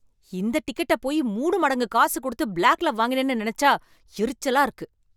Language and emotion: Tamil, angry